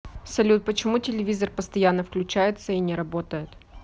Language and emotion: Russian, neutral